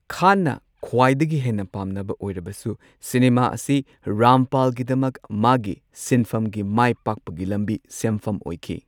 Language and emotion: Manipuri, neutral